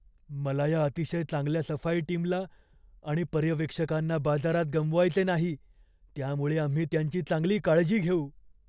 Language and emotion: Marathi, fearful